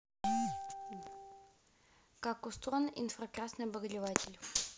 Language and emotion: Russian, neutral